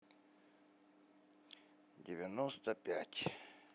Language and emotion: Russian, sad